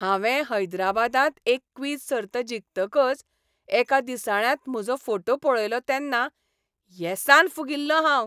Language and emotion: Goan Konkani, happy